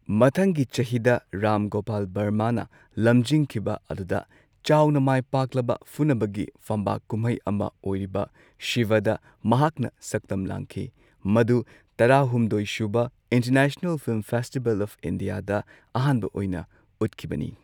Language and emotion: Manipuri, neutral